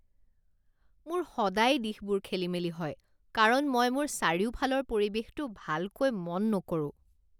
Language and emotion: Assamese, disgusted